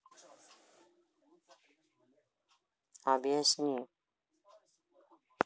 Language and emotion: Russian, neutral